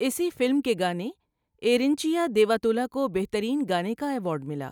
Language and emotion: Urdu, neutral